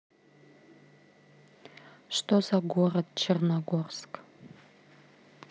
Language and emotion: Russian, neutral